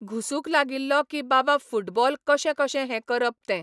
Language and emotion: Goan Konkani, neutral